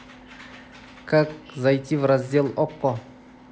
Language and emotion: Russian, neutral